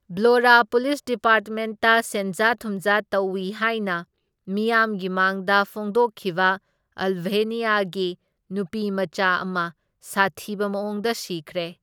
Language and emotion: Manipuri, neutral